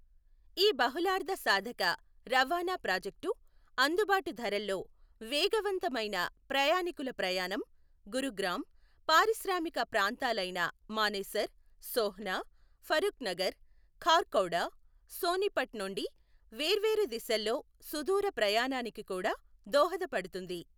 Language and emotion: Telugu, neutral